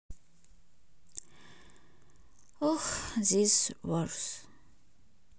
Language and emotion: Russian, sad